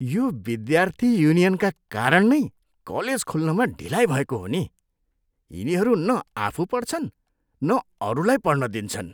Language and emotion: Nepali, disgusted